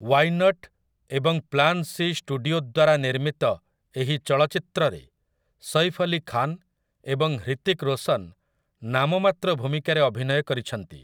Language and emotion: Odia, neutral